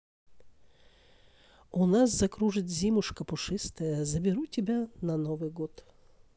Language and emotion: Russian, neutral